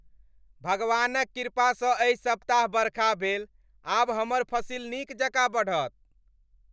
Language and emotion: Maithili, happy